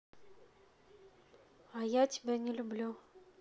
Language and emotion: Russian, neutral